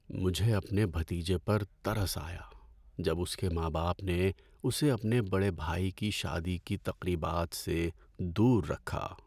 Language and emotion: Urdu, sad